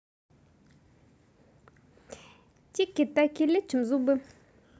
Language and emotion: Russian, positive